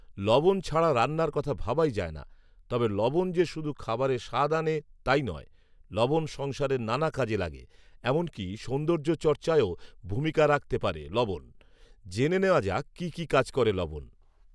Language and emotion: Bengali, neutral